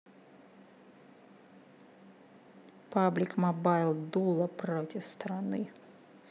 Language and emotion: Russian, neutral